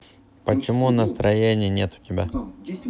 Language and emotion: Russian, neutral